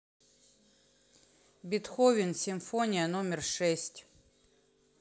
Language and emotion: Russian, neutral